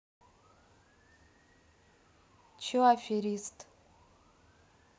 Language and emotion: Russian, neutral